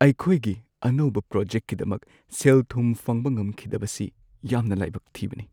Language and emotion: Manipuri, sad